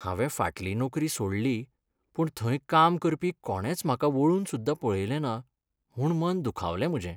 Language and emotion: Goan Konkani, sad